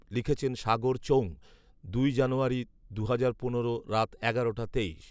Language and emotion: Bengali, neutral